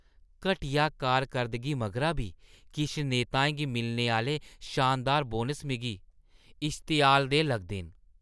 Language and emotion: Dogri, disgusted